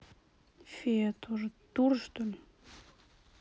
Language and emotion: Russian, sad